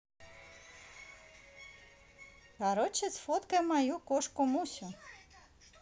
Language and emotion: Russian, positive